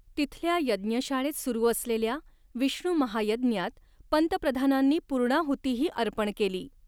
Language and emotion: Marathi, neutral